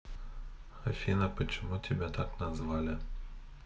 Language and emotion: Russian, neutral